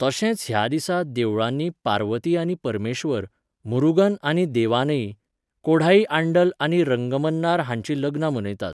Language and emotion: Goan Konkani, neutral